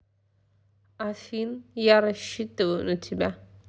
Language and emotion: Russian, neutral